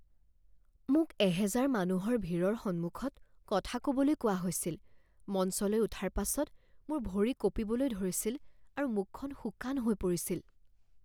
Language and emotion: Assamese, fearful